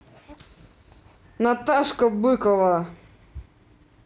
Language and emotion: Russian, neutral